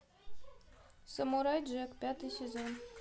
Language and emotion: Russian, neutral